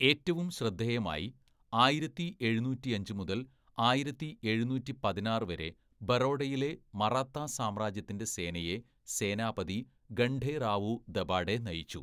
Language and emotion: Malayalam, neutral